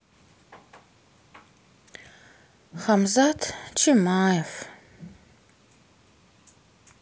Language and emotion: Russian, sad